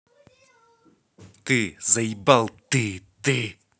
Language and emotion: Russian, angry